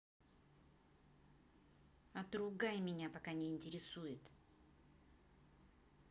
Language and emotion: Russian, angry